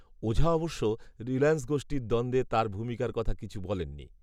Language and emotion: Bengali, neutral